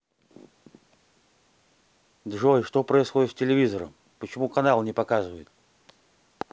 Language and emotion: Russian, angry